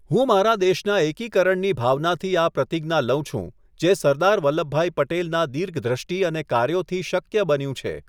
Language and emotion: Gujarati, neutral